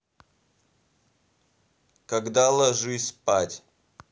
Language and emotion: Russian, angry